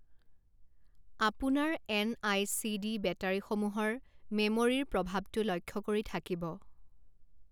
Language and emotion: Assamese, neutral